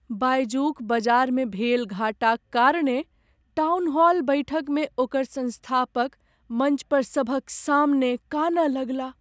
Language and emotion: Maithili, sad